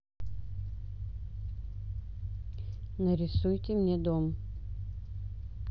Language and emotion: Russian, neutral